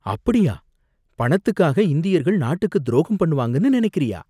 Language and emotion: Tamil, surprised